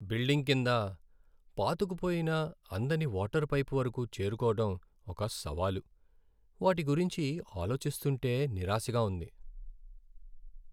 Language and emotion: Telugu, sad